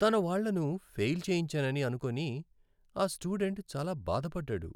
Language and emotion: Telugu, sad